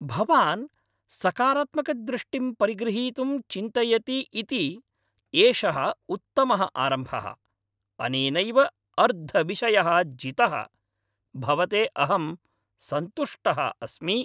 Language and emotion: Sanskrit, happy